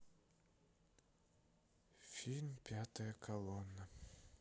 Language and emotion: Russian, sad